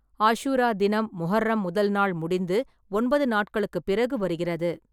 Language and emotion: Tamil, neutral